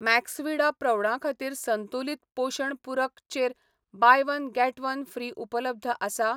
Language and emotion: Goan Konkani, neutral